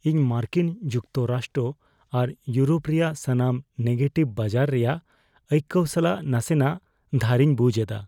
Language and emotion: Santali, fearful